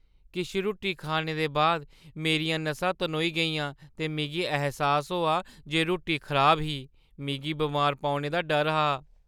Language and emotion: Dogri, fearful